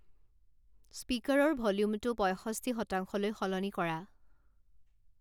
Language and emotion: Assamese, neutral